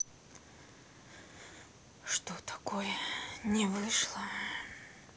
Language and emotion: Russian, sad